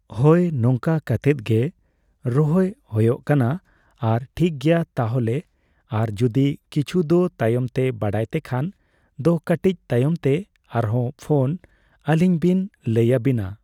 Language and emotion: Santali, neutral